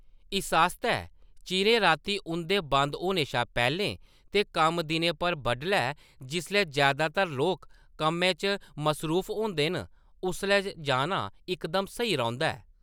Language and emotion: Dogri, neutral